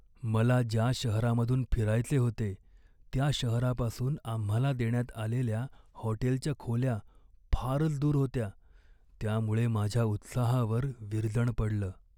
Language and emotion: Marathi, sad